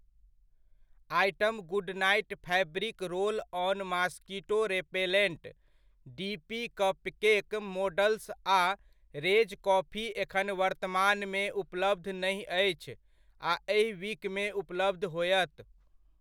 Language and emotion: Maithili, neutral